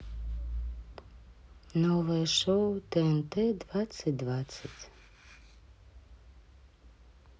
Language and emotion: Russian, sad